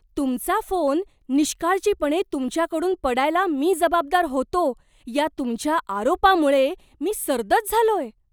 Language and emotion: Marathi, surprised